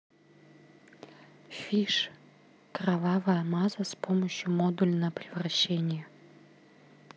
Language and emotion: Russian, neutral